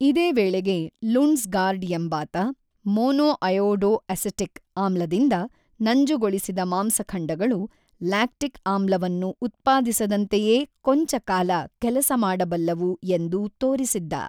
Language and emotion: Kannada, neutral